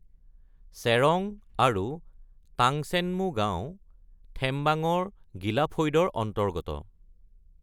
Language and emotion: Assamese, neutral